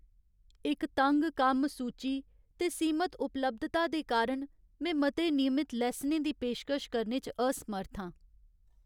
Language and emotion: Dogri, sad